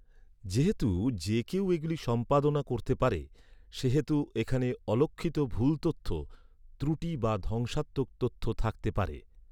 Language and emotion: Bengali, neutral